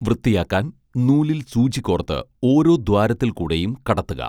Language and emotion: Malayalam, neutral